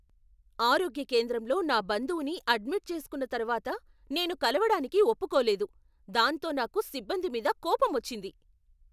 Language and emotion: Telugu, angry